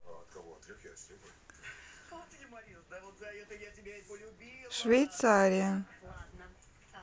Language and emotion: Russian, neutral